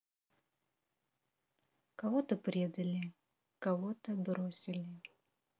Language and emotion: Russian, sad